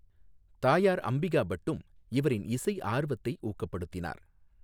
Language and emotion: Tamil, neutral